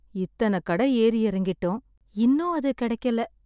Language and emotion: Tamil, sad